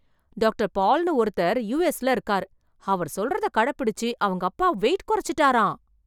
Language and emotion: Tamil, surprised